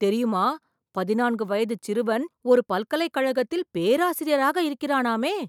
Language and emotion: Tamil, surprised